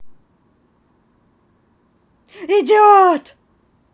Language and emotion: Russian, angry